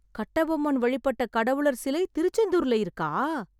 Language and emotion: Tamil, surprised